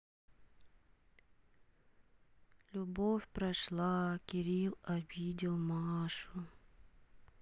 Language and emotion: Russian, sad